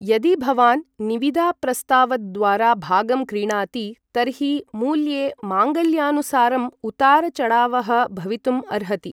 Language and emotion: Sanskrit, neutral